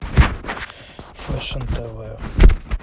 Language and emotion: Russian, neutral